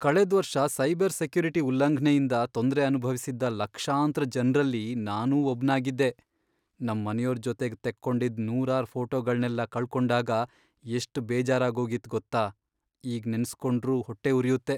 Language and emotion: Kannada, sad